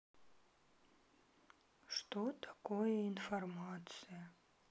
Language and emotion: Russian, sad